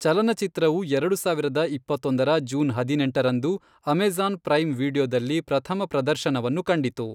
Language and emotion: Kannada, neutral